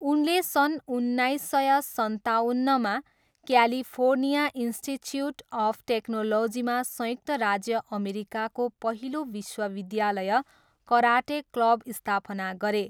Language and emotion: Nepali, neutral